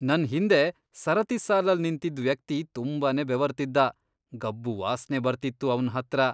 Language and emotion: Kannada, disgusted